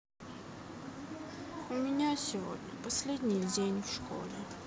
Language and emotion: Russian, sad